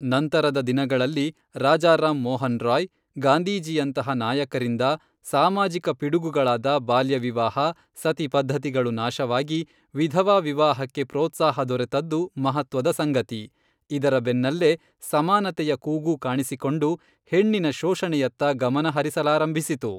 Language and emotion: Kannada, neutral